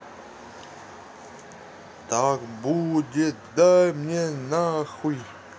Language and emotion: Russian, neutral